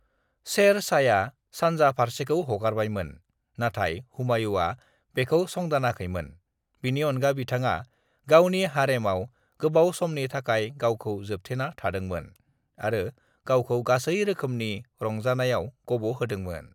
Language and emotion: Bodo, neutral